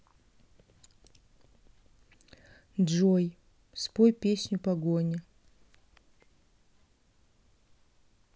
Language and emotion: Russian, neutral